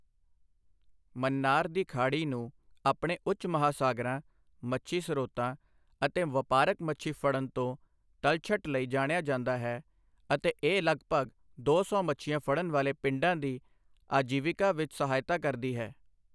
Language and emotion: Punjabi, neutral